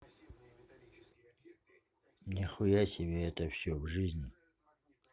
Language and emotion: Russian, neutral